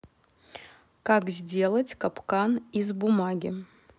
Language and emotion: Russian, neutral